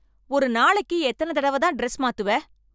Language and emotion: Tamil, angry